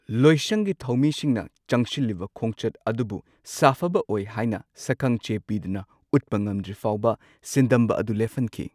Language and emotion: Manipuri, neutral